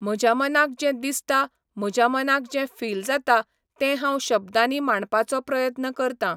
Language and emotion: Goan Konkani, neutral